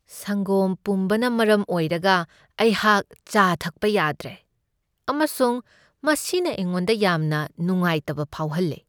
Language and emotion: Manipuri, sad